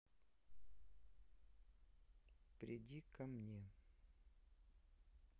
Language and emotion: Russian, neutral